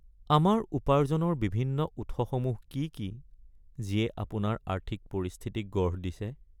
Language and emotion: Assamese, sad